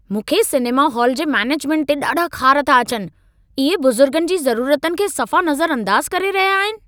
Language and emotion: Sindhi, angry